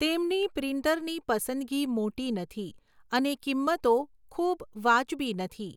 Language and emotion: Gujarati, neutral